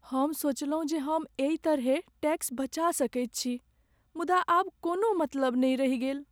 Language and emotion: Maithili, sad